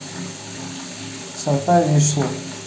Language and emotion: Russian, neutral